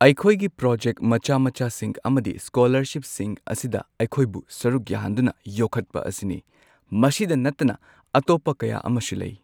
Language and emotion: Manipuri, neutral